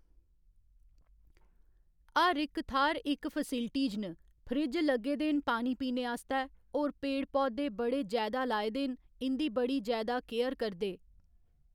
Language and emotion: Dogri, neutral